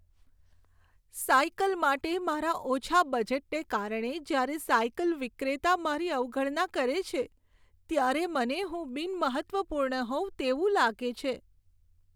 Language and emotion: Gujarati, sad